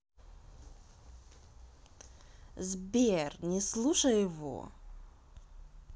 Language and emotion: Russian, neutral